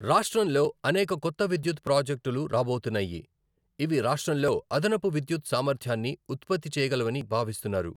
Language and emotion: Telugu, neutral